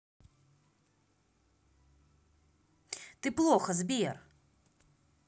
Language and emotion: Russian, angry